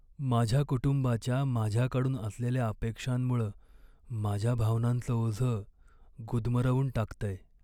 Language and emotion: Marathi, sad